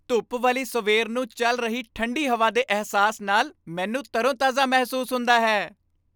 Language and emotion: Punjabi, happy